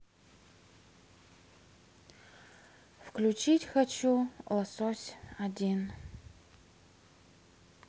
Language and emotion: Russian, sad